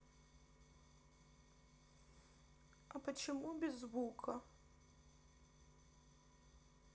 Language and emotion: Russian, sad